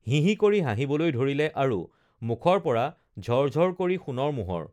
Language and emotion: Assamese, neutral